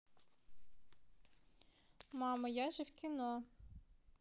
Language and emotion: Russian, neutral